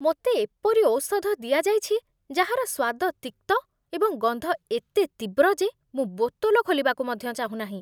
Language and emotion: Odia, disgusted